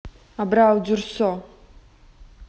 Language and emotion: Russian, neutral